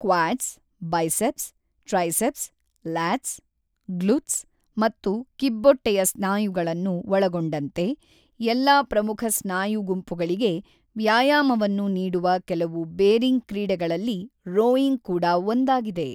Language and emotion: Kannada, neutral